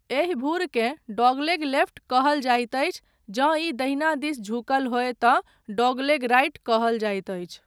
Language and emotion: Maithili, neutral